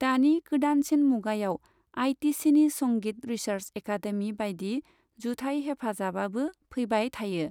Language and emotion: Bodo, neutral